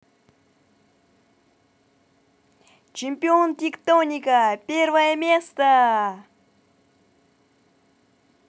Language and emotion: Russian, positive